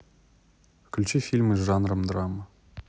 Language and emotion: Russian, neutral